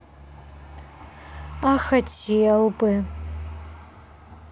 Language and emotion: Russian, sad